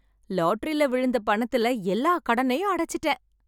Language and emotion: Tamil, happy